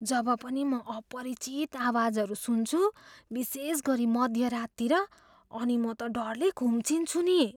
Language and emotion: Nepali, fearful